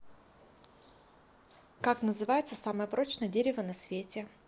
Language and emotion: Russian, neutral